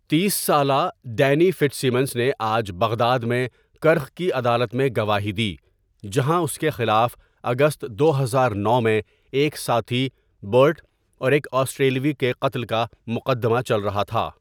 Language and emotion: Urdu, neutral